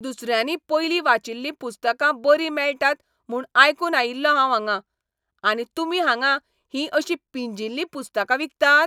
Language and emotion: Goan Konkani, angry